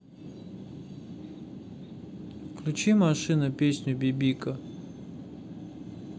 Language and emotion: Russian, neutral